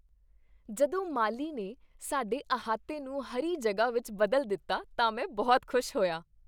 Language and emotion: Punjabi, happy